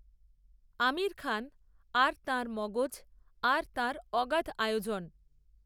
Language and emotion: Bengali, neutral